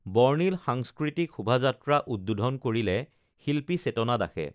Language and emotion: Assamese, neutral